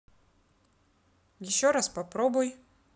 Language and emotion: Russian, neutral